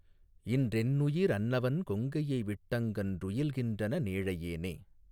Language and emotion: Tamil, neutral